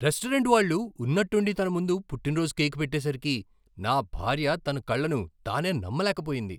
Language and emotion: Telugu, surprised